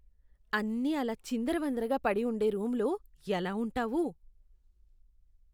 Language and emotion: Telugu, disgusted